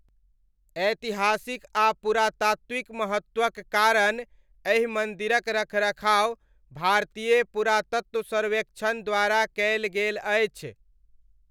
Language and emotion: Maithili, neutral